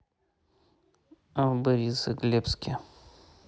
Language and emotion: Russian, neutral